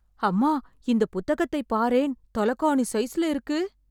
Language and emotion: Tamil, surprised